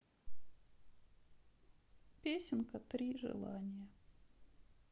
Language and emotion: Russian, sad